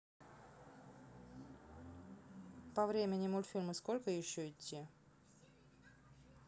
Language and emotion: Russian, neutral